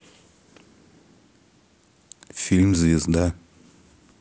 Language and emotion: Russian, neutral